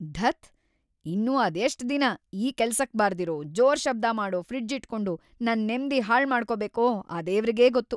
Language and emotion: Kannada, angry